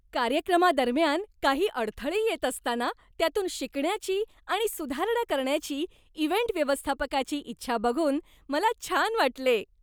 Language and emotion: Marathi, happy